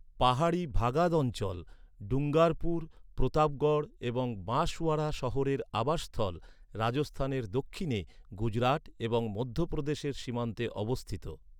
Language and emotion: Bengali, neutral